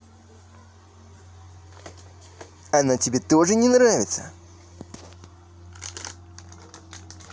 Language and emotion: Russian, neutral